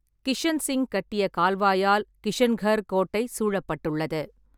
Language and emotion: Tamil, neutral